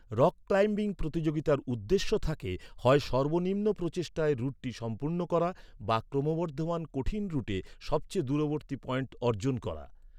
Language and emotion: Bengali, neutral